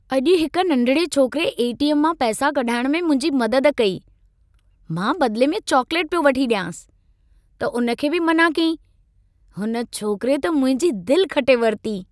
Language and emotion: Sindhi, happy